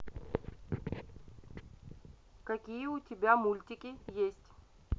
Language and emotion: Russian, neutral